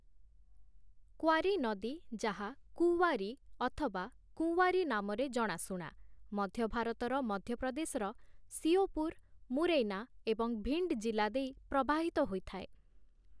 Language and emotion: Odia, neutral